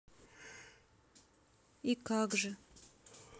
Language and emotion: Russian, sad